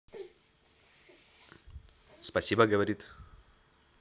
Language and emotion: Russian, neutral